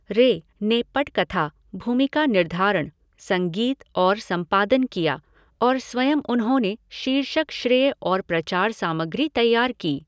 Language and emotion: Hindi, neutral